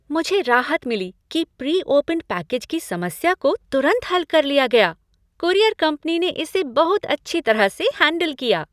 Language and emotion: Hindi, happy